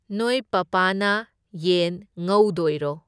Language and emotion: Manipuri, neutral